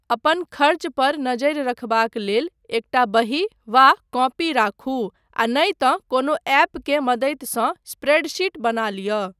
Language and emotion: Maithili, neutral